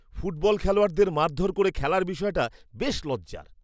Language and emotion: Bengali, disgusted